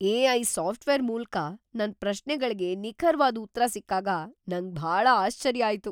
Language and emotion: Kannada, surprised